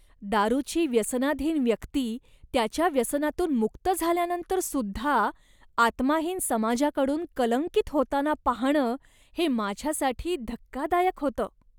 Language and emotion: Marathi, disgusted